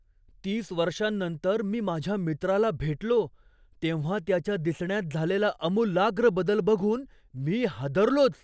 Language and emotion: Marathi, surprised